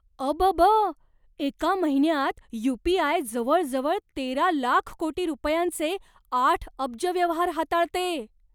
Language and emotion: Marathi, surprised